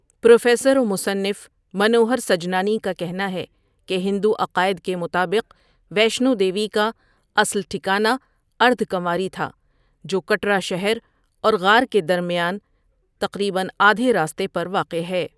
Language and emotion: Urdu, neutral